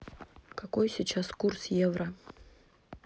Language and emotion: Russian, neutral